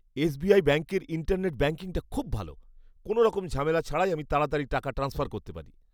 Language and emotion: Bengali, happy